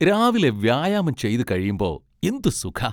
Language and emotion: Malayalam, happy